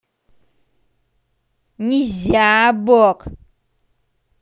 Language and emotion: Russian, angry